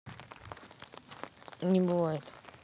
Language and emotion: Russian, neutral